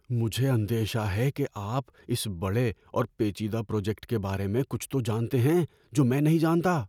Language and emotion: Urdu, fearful